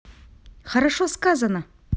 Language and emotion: Russian, positive